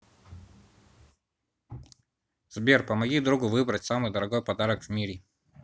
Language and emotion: Russian, neutral